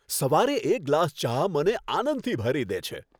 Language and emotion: Gujarati, happy